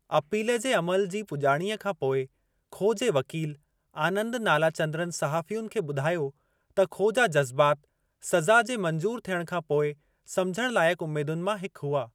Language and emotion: Sindhi, neutral